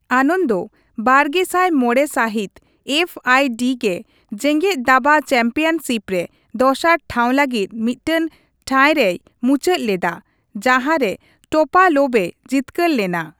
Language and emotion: Santali, neutral